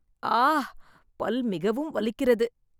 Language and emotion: Tamil, sad